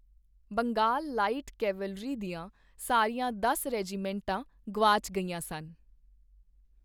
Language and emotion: Punjabi, neutral